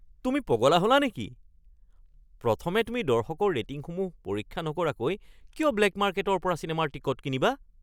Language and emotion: Assamese, surprised